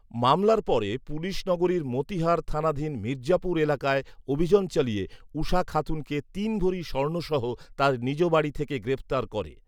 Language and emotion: Bengali, neutral